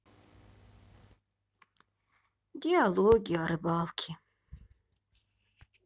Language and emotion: Russian, sad